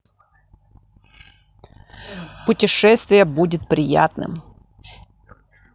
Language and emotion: Russian, neutral